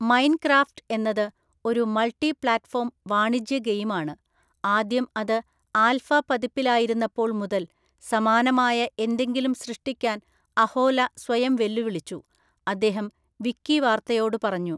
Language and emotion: Malayalam, neutral